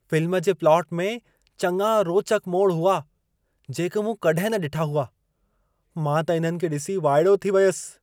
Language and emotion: Sindhi, surprised